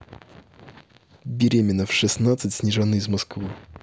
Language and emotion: Russian, neutral